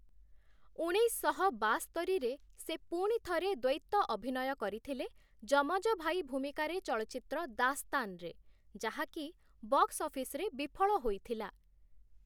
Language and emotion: Odia, neutral